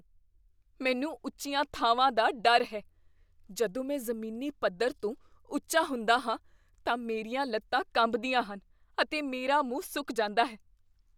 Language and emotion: Punjabi, fearful